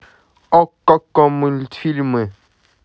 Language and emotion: Russian, positive